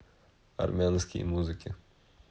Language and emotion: Russian, neutral